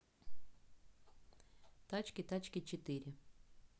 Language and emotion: Russian, neutral